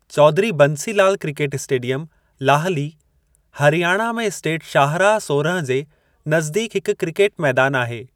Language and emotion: Sindhi, neutral